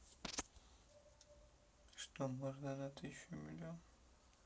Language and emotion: Russian, sad